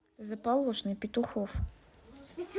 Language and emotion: Russian, neutral